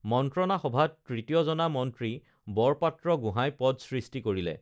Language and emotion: Assamese, neutral